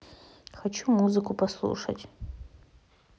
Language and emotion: Russian, neutral